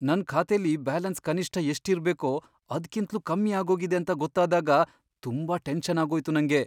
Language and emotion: Kannada, fearful